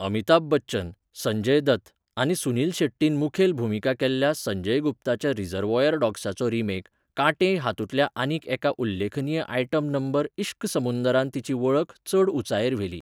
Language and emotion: Goan Konkani, neutral